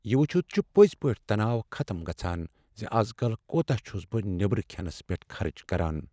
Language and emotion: Kashmiri, sad